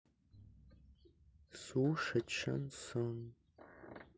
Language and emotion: Russian, sad